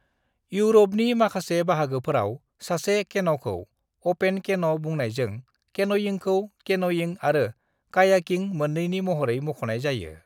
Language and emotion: Bodo, neutral